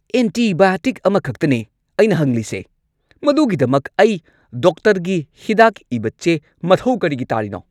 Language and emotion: Manipuri, angry